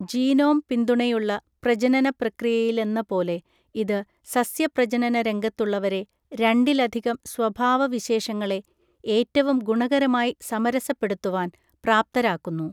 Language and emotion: Malayalam, neutral